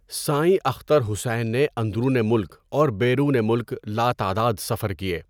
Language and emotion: Urdu, neutral